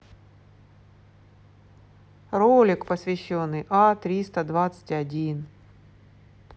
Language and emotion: Russian, neutral